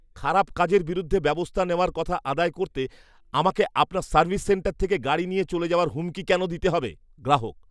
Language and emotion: Bengali, disgusted